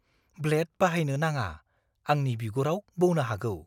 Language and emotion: Bodo, fearful